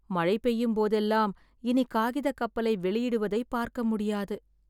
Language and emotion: Tamil, sad